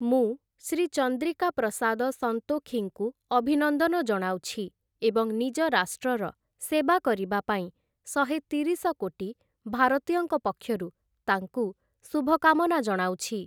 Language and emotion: Odia, neutral